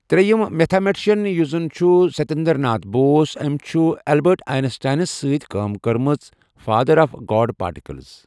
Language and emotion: Kashmiri, neutral